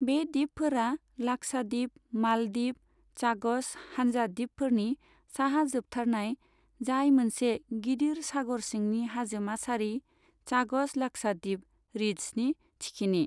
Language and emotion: Bodo, neutral